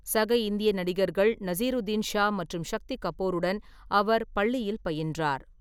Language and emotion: Tamil, neutral